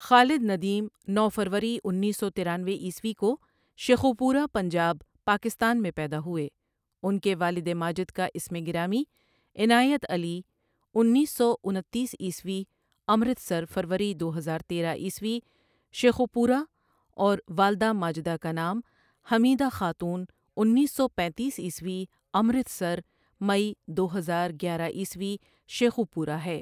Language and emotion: Urdu, neutral